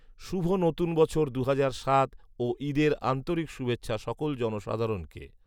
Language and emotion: Bengali, neutral